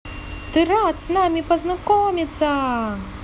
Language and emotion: Russian, positive